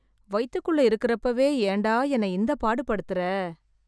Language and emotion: Tamil, sad